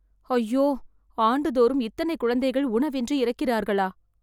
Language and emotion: Tamil, sad